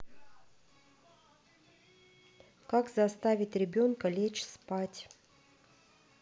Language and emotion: Russian, neutral